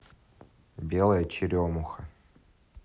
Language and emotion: Russian, neutral